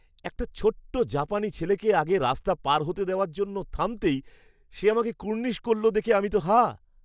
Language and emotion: Bengali, surprised